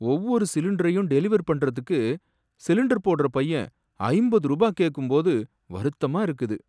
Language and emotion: Tamil, sad